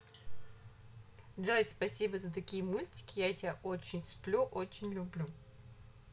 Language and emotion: Russian, positive